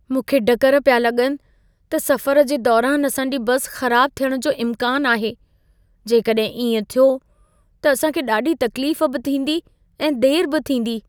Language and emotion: Sindhi, fearful